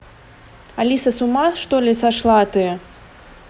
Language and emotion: Russian, angry